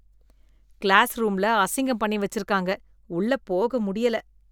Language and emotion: Tamil, disgusted